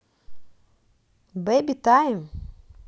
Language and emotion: Russian, positive